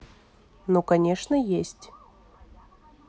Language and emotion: Russian, neutral